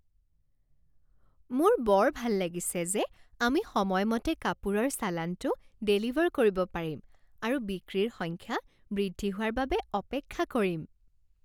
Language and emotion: Assamese, happy